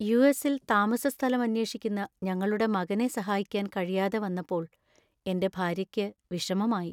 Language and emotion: Malayalam, sad